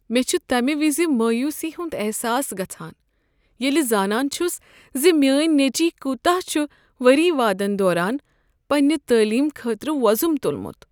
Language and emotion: Kashmiri, sad